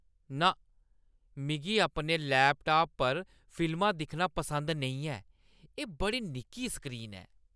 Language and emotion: Dogri, disgusted